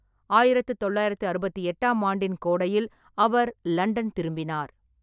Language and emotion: Tamil, neutral